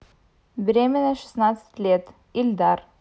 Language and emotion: Russian, neutral